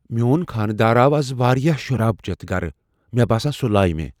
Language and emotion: Kashmiri, fearful